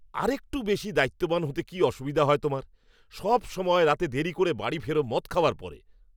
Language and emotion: Bengali, angry